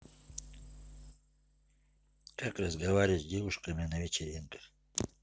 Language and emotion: Russian, neutral